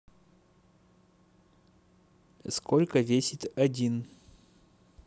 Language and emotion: Russian, neutral